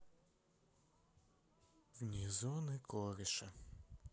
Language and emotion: Russian, sad